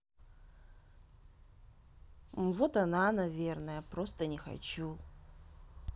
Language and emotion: Russian, neutral